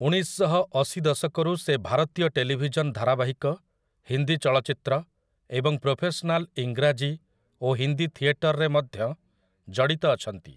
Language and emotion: Odia, neutral